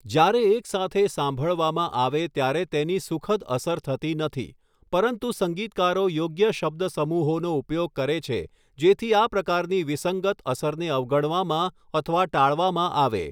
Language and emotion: Gujarati, neutral